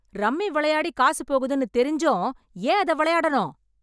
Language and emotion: Tamil, angry